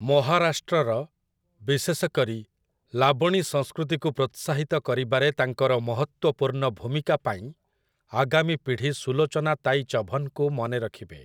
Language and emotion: Odia, neutral